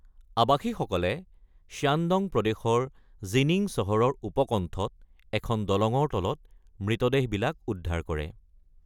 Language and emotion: Assamese, neutral